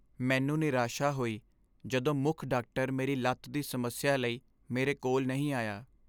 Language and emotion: Punjabi, sad